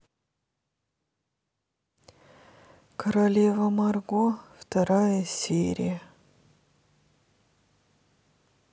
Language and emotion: Russian, sad